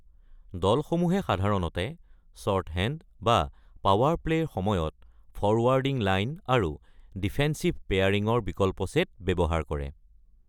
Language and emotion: Assamese, neutral